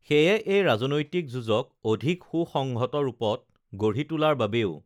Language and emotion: Assamese, neutral